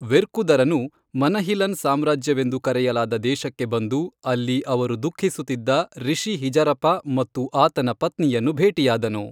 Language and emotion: Kannada, neutral